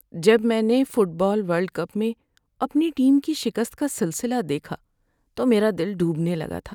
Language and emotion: Urdu, sad